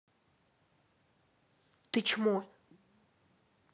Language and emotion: Russian, angry